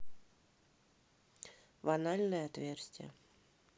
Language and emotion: Russian, neutral